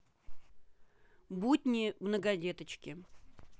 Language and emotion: Russian, neutral